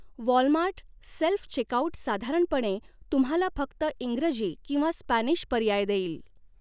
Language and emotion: Marathi, neutral